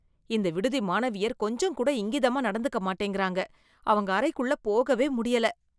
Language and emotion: Tamil, disgusted